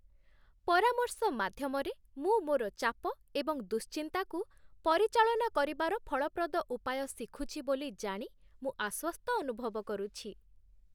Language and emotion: Odia, happy